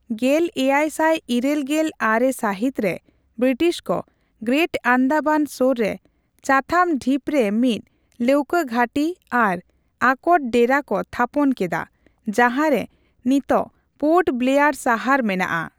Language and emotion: Santali, neutral